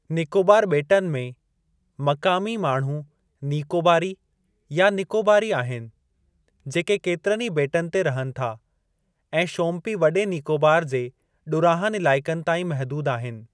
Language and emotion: Sindhi, neutral